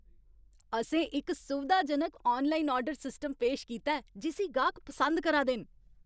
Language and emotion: Dogri, happy